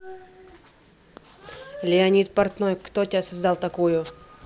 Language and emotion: Russian, neutral